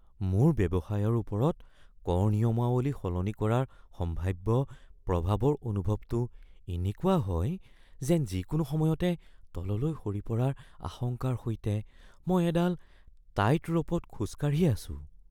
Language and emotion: Assamese, fearful